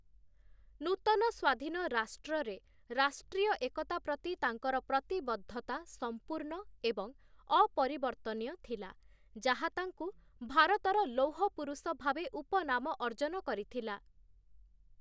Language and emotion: Odia, neutral